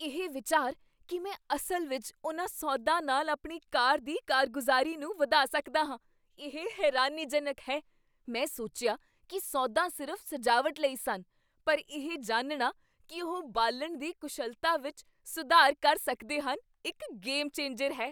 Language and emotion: Punjabi, surprised